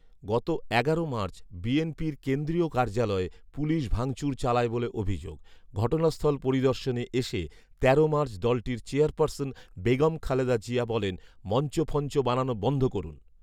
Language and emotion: Bengali, neutral